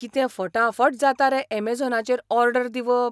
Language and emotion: Goan Konkani, surprised